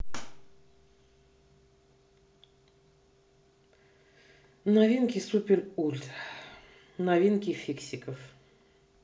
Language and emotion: Russian, neutral